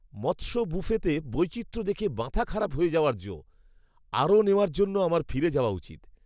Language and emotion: Bengali, surprised